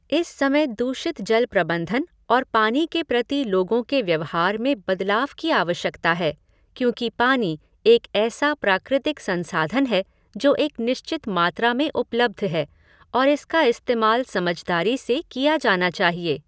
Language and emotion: Hindi, neutral